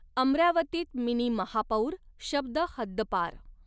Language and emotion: Marathi, neutral